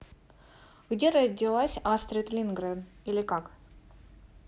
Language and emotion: Russian, neutral